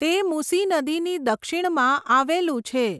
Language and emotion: Gujarati, neutral